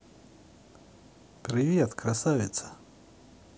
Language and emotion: Russian, positive